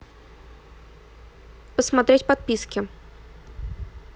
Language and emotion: Russian, neutral